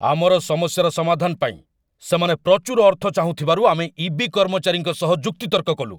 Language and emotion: Odia, angry